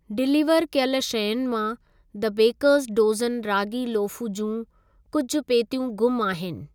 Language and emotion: Sindhi, neutral